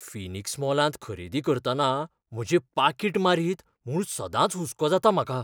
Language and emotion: Goan Konkani, fearful